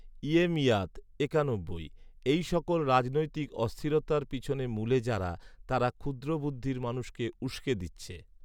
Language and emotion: Bengali, neutral